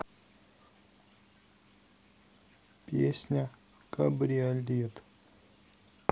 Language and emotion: Russian, neutral